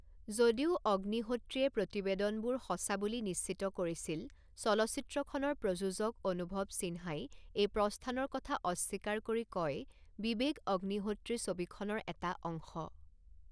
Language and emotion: Assamese, neutral